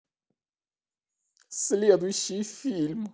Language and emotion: Russian, sad